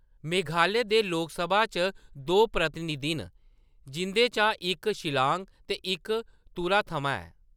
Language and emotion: Dogri, neutral